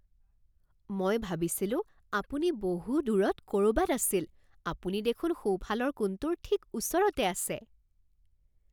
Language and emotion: Assamese, surprised